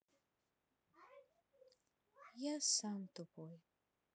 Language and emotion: Russian, sad